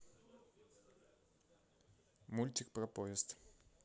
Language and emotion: Russian, neutral